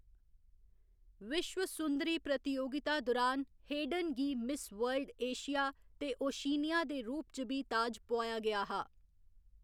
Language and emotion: Dogri, neutral